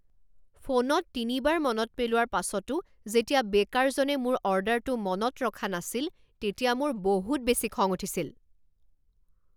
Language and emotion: Assamese, angry